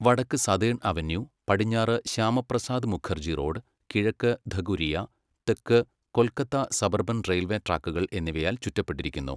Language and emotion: Malayalam, neutral